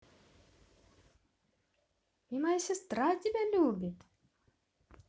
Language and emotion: Russian, positive